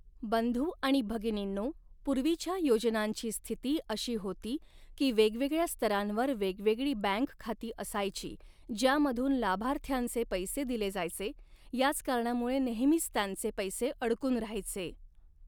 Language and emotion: Marathi, neutral